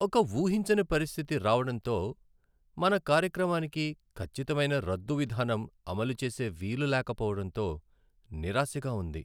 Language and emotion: Telugu, sad